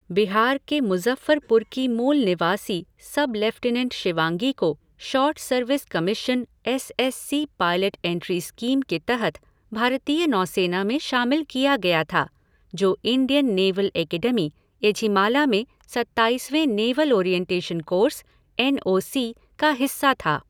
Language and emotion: Hindi, neutral